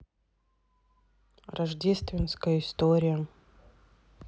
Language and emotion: Russian, neutral